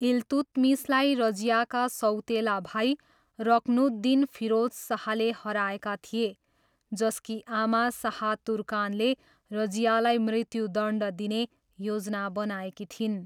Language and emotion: Nepali, neutral